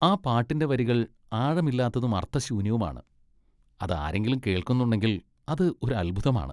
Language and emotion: Malayalam, disgusted